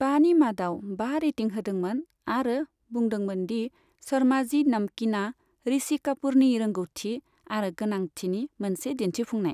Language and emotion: Bodo, neutral